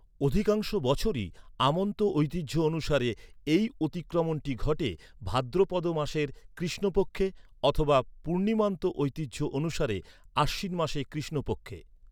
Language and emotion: Bengali, neutral